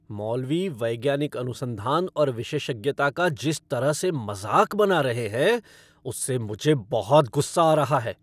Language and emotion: Hindi, angry